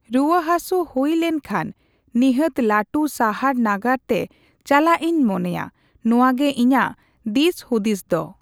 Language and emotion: Santali, neutral